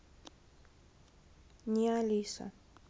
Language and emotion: Russian, neutral